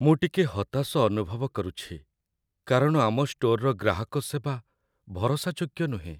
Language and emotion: Odia, sad